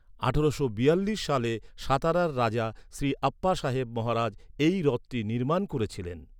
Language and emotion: Bengali, neutral